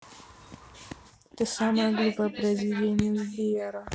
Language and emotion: Russian, neutral